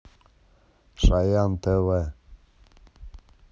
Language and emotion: Russian, neutral